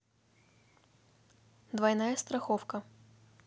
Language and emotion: Russian, neutral